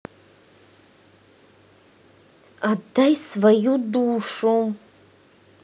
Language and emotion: Russian, angry